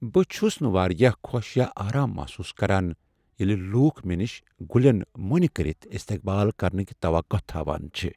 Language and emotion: Kashmiri, sad